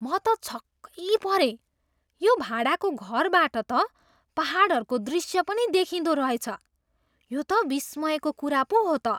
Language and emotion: Nepali, surprised